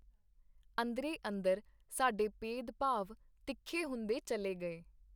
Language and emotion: Punjabi, neutral